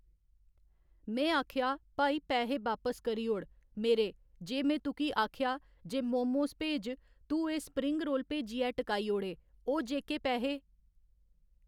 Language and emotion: Dogri, neutral